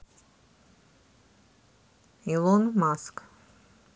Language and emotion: Russian, neutral